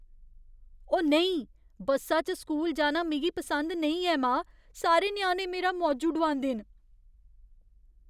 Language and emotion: Dogri, fearful